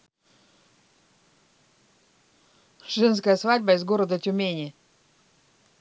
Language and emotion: Russian, neutral